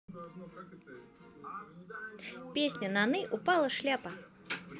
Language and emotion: Russian, neutral